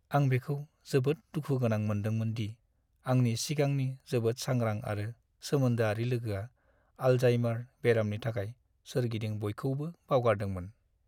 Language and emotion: Bodo, sad